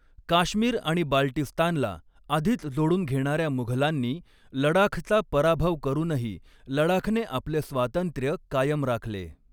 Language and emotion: Marathi, neutral